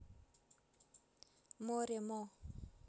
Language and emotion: Russian, neutral